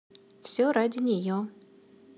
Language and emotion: Russian, neutral